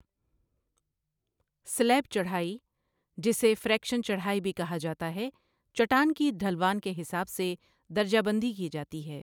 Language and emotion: Urdu, neutral